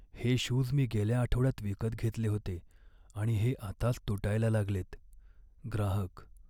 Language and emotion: Marathi, sad